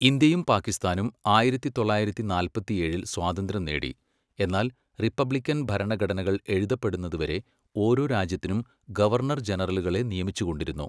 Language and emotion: Malayalam, neutral